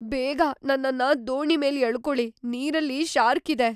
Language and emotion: Kannada, fearful